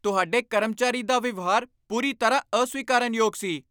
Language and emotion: Punjabi, angry